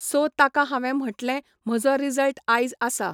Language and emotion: Goan Konkani, neutral